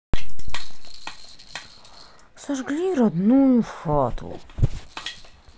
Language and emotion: Russian, sad